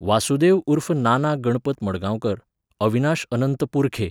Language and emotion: Goan Konkani, neutral